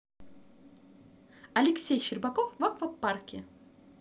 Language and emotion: Russian, positive